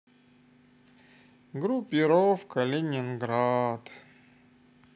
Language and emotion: Russian, sad